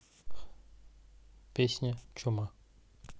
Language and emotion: Russian, neutral